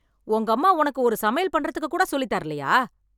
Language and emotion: Tamil, angry